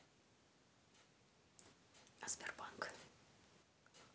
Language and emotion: Russian, neutral